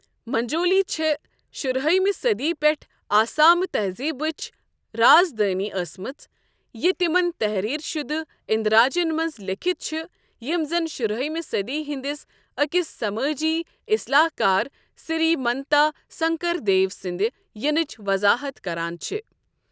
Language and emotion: Kashmiri, neutral